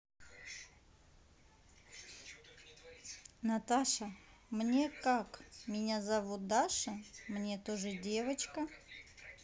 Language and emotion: Russian, neutral